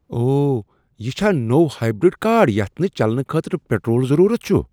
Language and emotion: Kashmiri, surprised